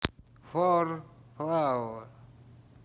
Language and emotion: Russian, neutral